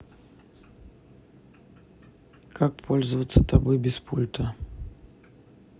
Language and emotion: Russian, neutral